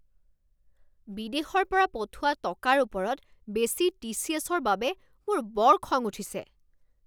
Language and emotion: Assamese, angry